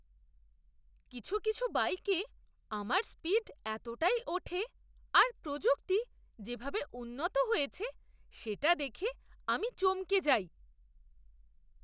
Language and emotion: Bengali, surprised